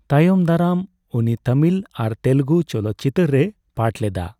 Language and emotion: Santali, neutral